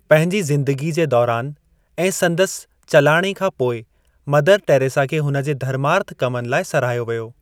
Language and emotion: Sindhi, neutral